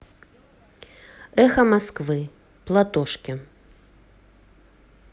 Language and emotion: Russian, neutral